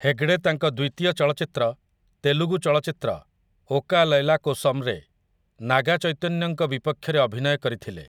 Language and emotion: Odia, neutral